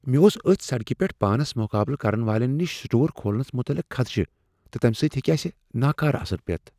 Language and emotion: Kashmiri, fearful